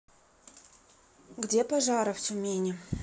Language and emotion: Russian, neutral